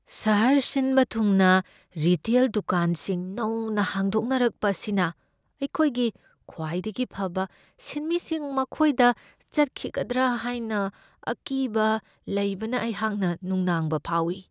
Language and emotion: Manipuri, fearful